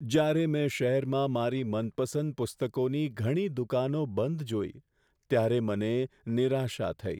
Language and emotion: Gujarati, sad